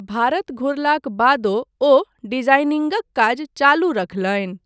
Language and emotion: Maithili, neutral